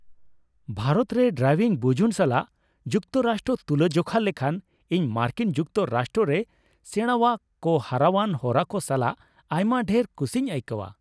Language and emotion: Santali, happy